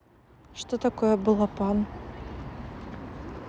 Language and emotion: Russian, neutral